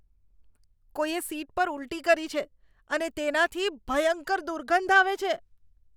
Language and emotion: Gujarati, disgusted